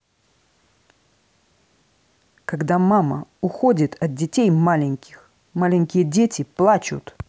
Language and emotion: Russian, angry